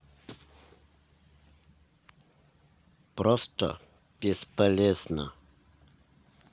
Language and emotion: Russian, neutral